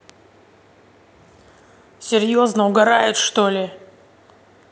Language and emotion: Russian, angry